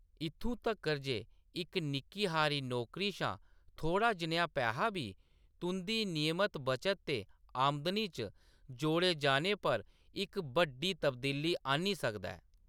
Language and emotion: Dogri, neutral